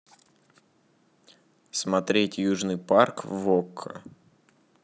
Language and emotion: Russian, neutral